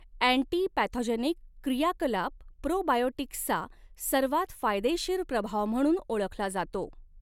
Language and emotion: Marathi, neutral